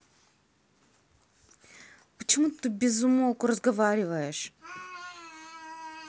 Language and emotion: Russian, angry